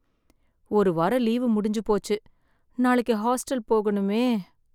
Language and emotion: Tamil, sad